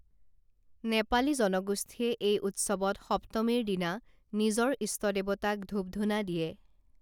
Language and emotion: Assamese, neutral